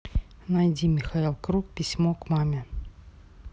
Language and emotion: Russian, neutral